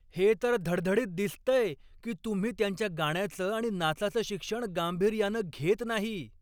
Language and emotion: Marathi, angry